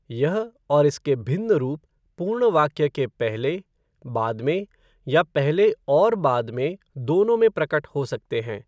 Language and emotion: Hindi, neutral